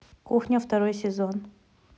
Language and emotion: Russian, neutral